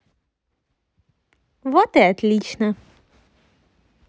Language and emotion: Russian, positive